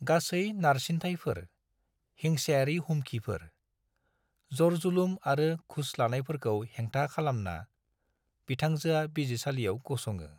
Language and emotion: Bodo, neutral